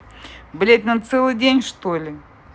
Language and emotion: Russian, angry